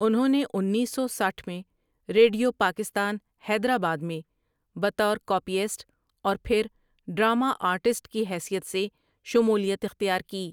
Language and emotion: Urdu, neutral